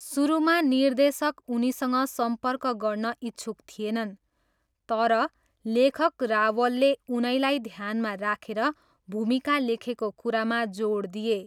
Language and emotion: Nepali, neutral